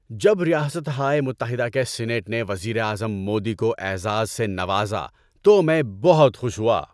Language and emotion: Urdu, happy